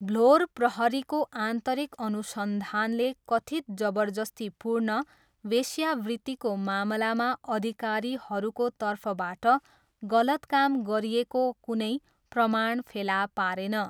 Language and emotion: Nepali, neutral